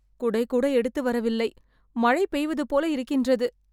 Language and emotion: Tamil, fearful